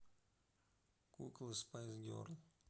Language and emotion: Russian, neutral